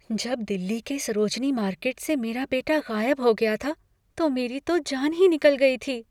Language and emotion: Hindi, fearful